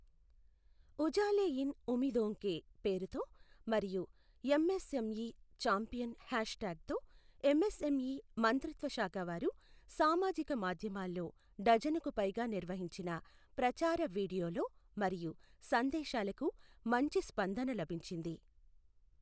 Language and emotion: Telugu, neutral